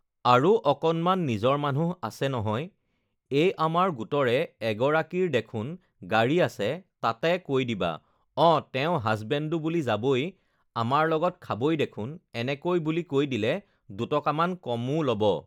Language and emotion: Assamese, neutral